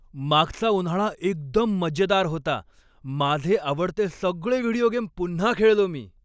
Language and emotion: Marathi, happy